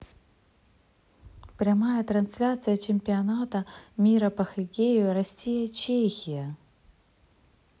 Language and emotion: Russian, neutral